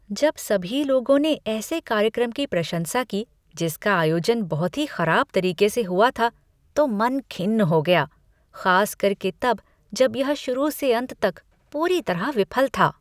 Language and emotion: Hindi, disgusted